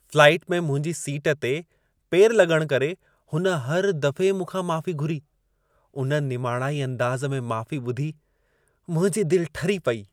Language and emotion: Sindhi, happy